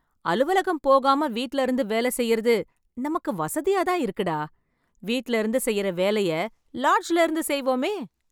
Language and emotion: Tamil, happy